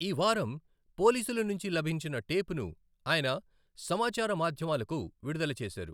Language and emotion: Telugu, neutral